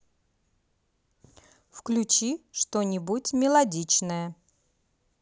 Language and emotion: Russian, positive